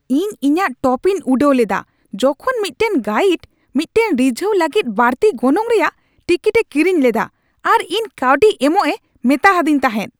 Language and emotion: Santali, angry